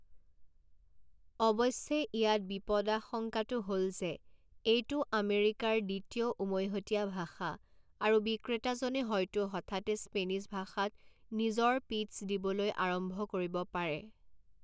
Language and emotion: Assamese, neutral